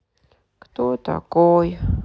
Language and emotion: Russian, sad